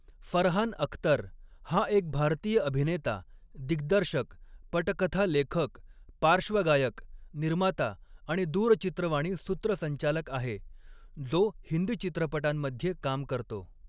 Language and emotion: Marathi, neutral